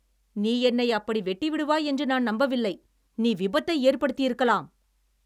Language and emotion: Tamil, angry